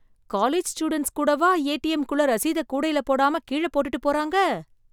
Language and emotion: Tamil, surprised